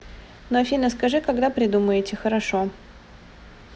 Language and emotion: Russian, neutral